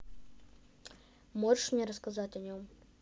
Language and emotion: Russian, neutral